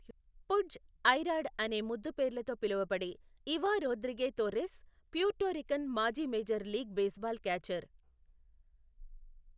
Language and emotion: Telugu, neutral